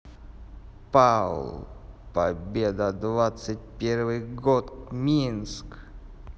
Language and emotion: Russian, neutral